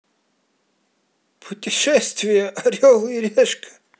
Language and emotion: Russian, positive